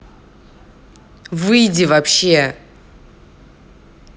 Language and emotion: Russian, angry